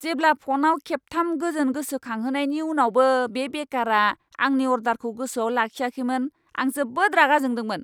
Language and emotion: Bodo, angry